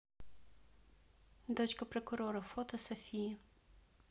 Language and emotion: Russian, neutral